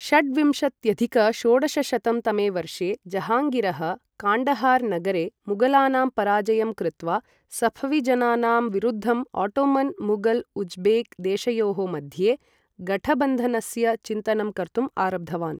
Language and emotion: Sanskrit, neutral